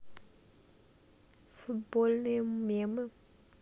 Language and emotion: Russian, neutral